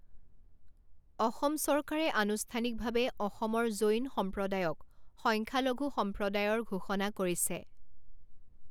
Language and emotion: Assamese, neutral